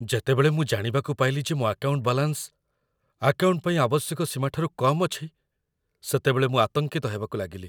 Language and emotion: Odia, fearful